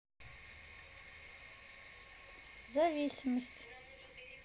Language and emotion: Russian, neutral